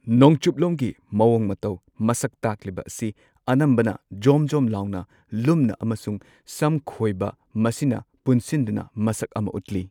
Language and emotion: Manipuri, neutral